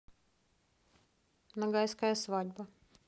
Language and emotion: Russian, neutral